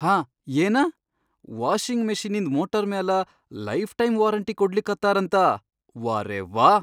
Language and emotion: Kannada, surprised